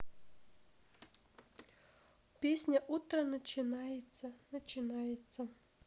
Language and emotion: Russian, neutral